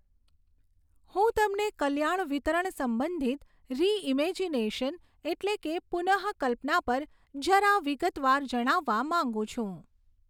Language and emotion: Gujarati, neutral